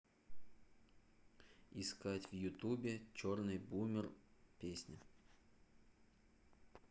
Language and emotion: Russian, neutral